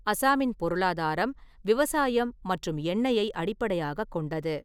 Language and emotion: Tamil, neutral